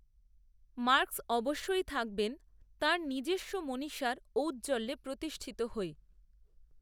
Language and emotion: Bengali, neutral